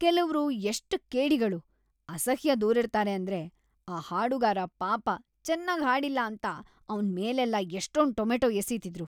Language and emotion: Kannada, disgusted